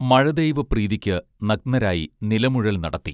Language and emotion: Malayalam, neutral